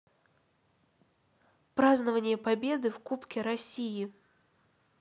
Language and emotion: Russian, neutral